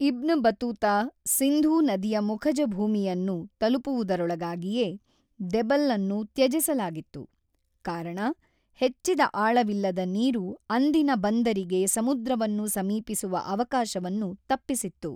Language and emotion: Kannada, neutral